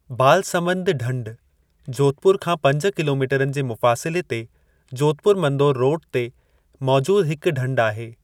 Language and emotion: Sindhi, neutral